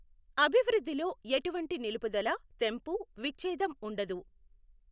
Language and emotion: Telugu, neutral